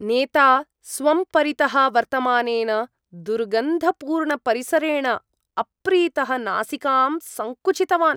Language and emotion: Sanskrit, disgusted